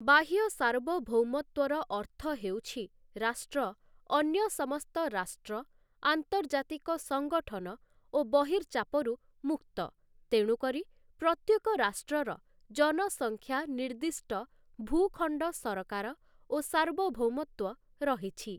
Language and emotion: Odia, neutral